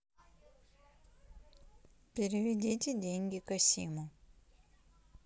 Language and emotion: Russian, neutral